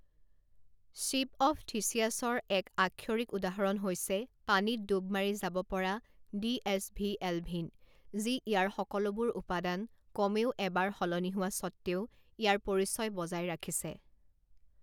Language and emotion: Assamese, neutral